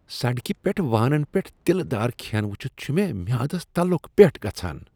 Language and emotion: Kashmiri, disgusted